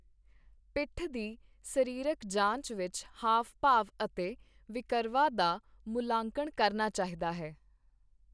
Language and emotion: Punjabi, neutral